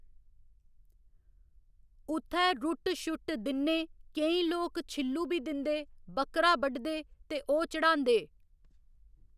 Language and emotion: Dogri, neutral